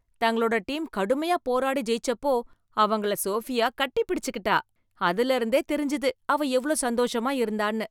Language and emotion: Tamil, happy